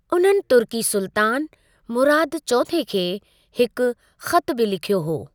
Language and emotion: Sindhi, neutral